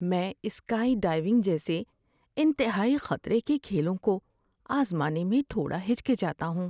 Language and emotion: Urdu, fearful